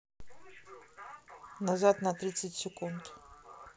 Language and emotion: Russian, neutral